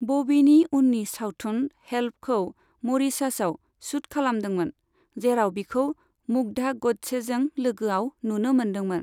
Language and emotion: Bodo, neutral